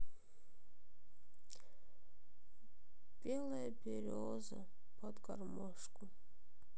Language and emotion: Russian, sad